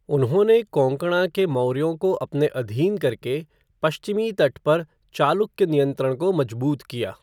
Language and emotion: Hindi, neutral